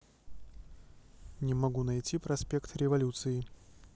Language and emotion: Russian, neutral